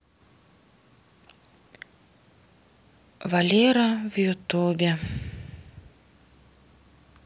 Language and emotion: Russian, sad